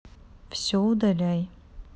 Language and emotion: Russian, neutral